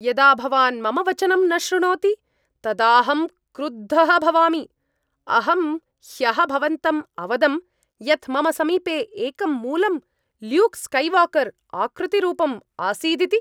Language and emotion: Sanskrit, angry